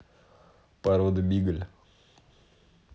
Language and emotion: Russian, neutral